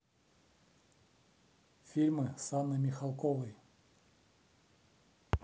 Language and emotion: Russian, neutral